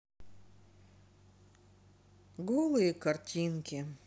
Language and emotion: Russian, sad